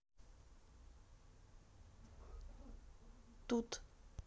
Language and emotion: Russian, neutral